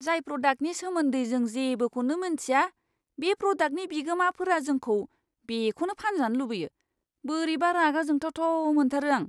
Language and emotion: Bodo, disgusted